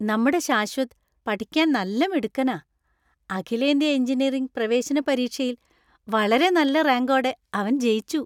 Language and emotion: Malayalam, happy